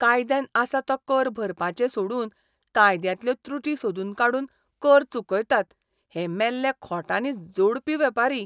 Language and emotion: Goan Konkani, disgusted